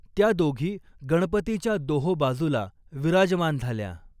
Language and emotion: Marathi, neutral